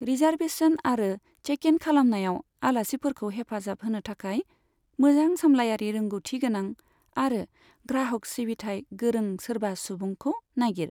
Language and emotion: Bodo, neutral